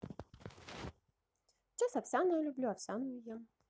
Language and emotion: Russian, positive